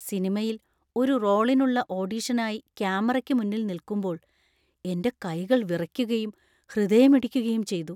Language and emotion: Malayalam, fearful